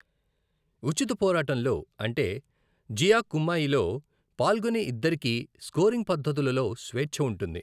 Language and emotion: Telugu, neutral